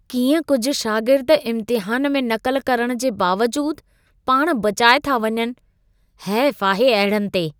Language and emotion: Sindhi, disgusted